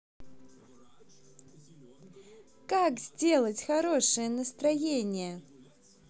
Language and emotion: Russian, positive